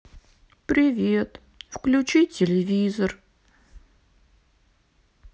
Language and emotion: Russian, sad